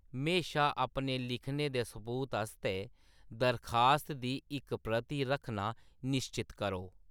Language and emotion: Dogri, neutral